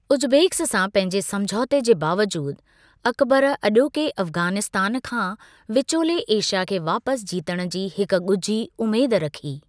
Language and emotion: Sindhi, neutral